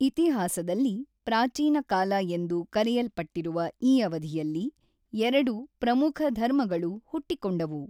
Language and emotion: Kannada, neutral